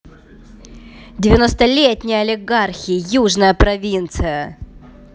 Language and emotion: Russian, angry